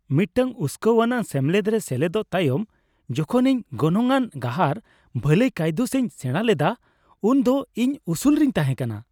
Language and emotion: Santali, happy